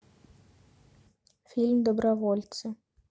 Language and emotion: Russian, neutral